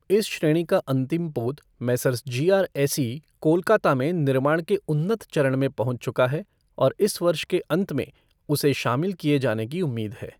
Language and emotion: Hindi, neutral